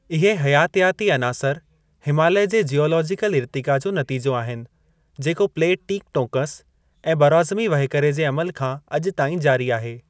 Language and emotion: Sindhi, neutral